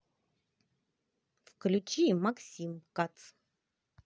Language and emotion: Russian, positive